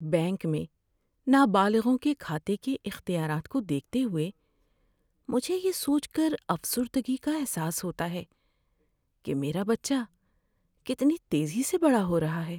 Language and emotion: Urdu, sad